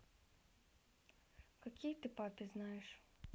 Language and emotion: Russian, neutral